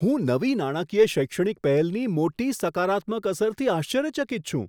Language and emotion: Gujarati, surprised